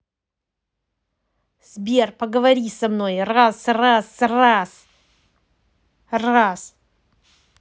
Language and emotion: Russian, angry